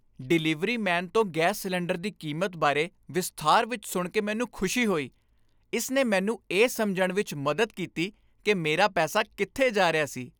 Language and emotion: Punjabi, happy